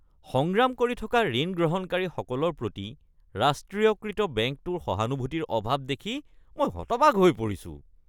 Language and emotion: Assamese, disgusted